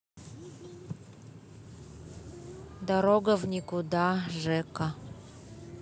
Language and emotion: Russian, neutral